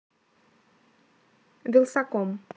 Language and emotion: Russian, neutral